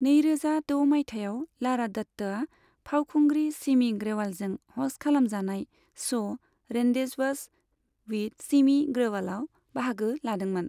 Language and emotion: Bodo, neutral